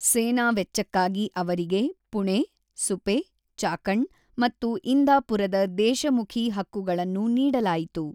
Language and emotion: Kannada, neutral